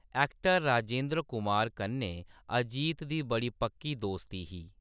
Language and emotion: Dogri, neutral